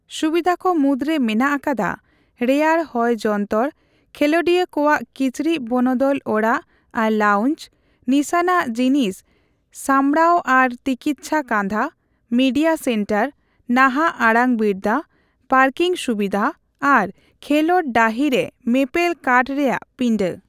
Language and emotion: Santali, neutral